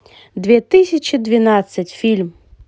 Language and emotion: Russian, positive